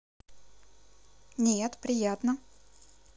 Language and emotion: Russian, positive